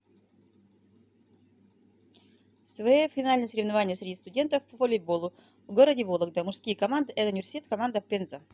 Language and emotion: Russian, neutral